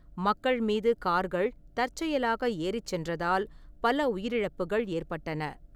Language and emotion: Tamil, neutral